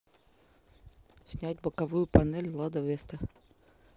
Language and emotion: Russian, neutral